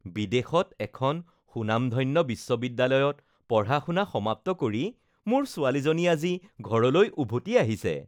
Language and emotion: Assamese, happy